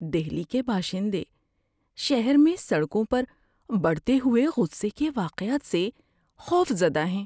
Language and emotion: Urdu, fearful